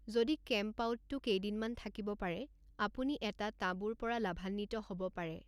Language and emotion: Assamese, neutral